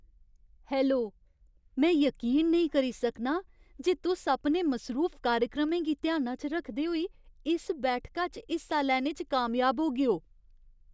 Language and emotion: Dogri, surprised